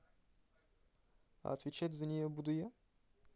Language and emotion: Russian, neutral